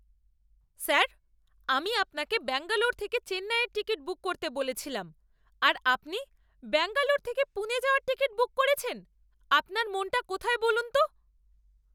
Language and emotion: Bengali, angry